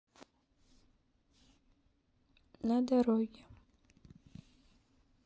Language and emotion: Russian, sad